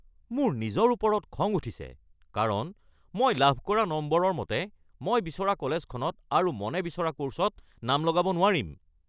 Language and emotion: Assamese, angry